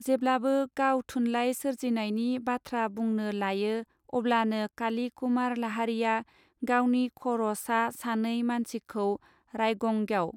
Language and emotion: Bodo, neutral